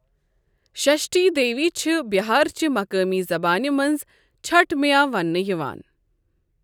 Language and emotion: Kashmiri, neutral